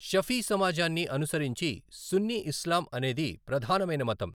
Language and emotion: Telugu, neutral